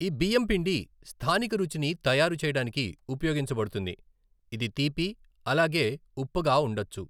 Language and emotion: Telugu, neutral